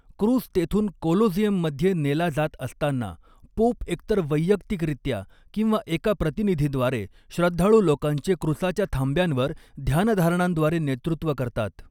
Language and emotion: Marathi, neutral